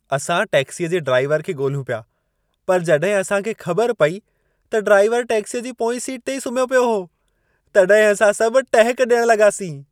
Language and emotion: Sindhi, happy